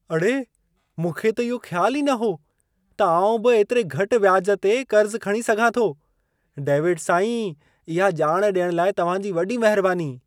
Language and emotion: Sindhi, surprised